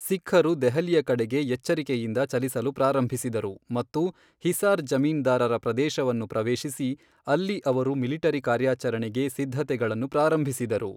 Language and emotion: Kannada, neutral